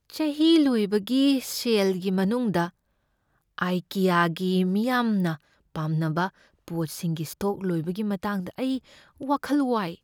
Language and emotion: Manipuri, fearful